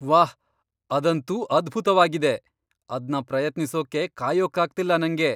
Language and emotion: Kannada, surprised